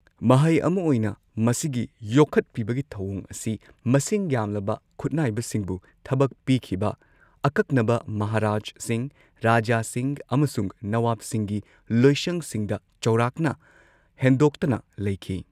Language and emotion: Manipuri, neutral